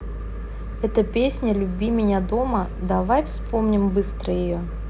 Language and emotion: Russian, neutral